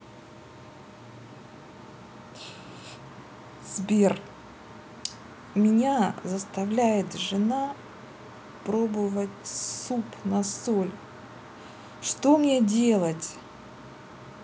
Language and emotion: Russian, neutral